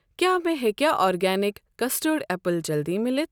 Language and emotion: Kashmiri, neutral